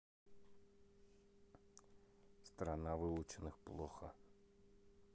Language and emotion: Russian, sad